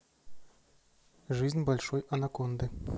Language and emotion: Russian, neutral